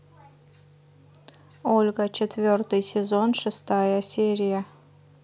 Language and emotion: Russian, neutral